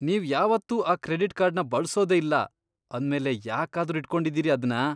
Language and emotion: Kannada, disgusted